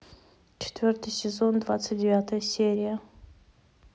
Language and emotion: Russian, neutral